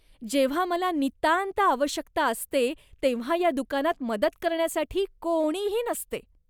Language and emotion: Marathi, disgusted